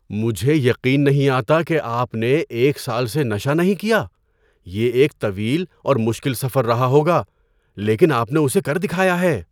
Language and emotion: Urdu, surprised